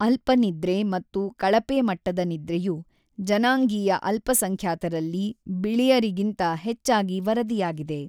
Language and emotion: Kannada, neutral